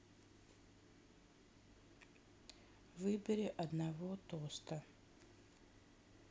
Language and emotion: Russian, neutral